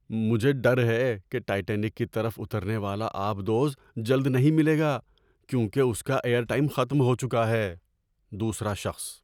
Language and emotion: Urdu, fearful